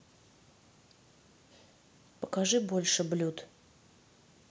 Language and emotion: Russian, neutral